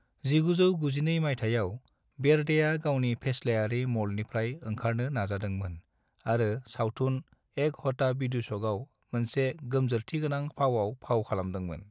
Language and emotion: Bodo, neutral